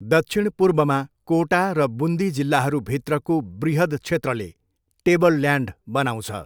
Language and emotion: Nepali, neutral